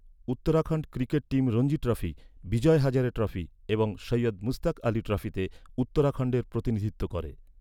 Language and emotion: Bengali, neutral